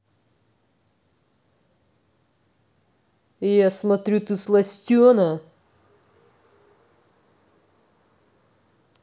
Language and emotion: Russian, angry